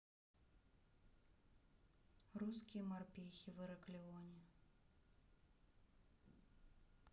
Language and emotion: Russian, neutral